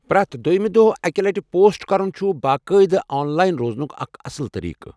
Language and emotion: Kashmiri, neutral